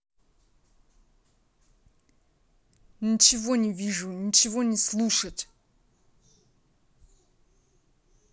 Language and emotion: Russian, angry